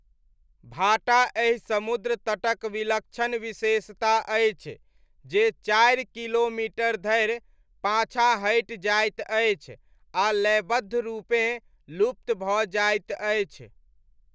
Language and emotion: Maithili, neutral